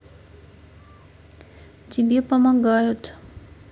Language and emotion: Russian, neutral